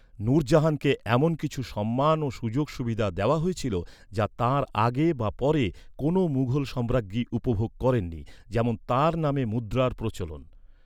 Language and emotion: Bengali, neutral